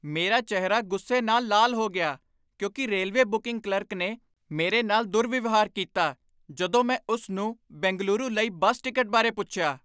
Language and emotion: Punjabi, angry